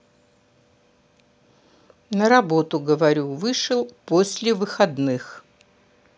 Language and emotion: Russian, neutral